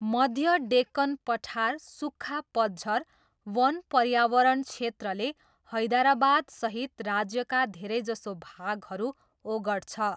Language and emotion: Nepali, neutral